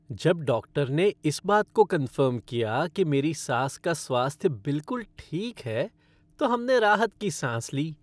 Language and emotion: Hindi, happy